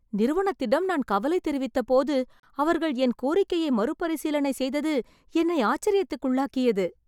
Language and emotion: Tamil, surprised